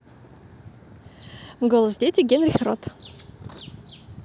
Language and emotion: Russian, positive